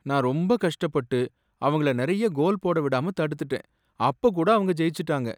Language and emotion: Tamil, sad